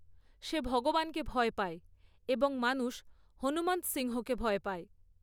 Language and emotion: Bengali, neutral